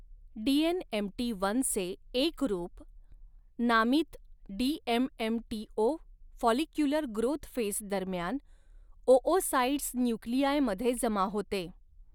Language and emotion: Marathi, neutral